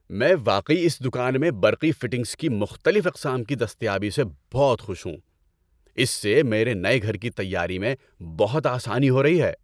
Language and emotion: Urdu, happy